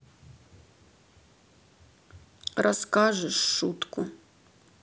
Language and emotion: Russian, sad